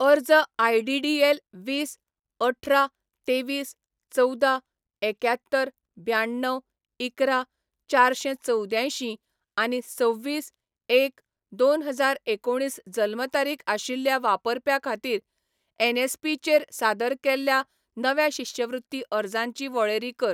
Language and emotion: Goan Konkani, neutral